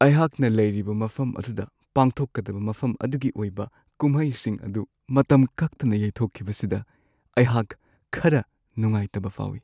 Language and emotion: Manipuri, sad